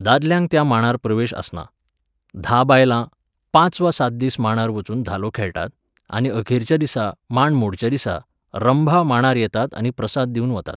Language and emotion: Goan Konkani, neutral